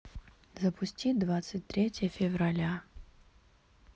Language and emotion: Russian, neutral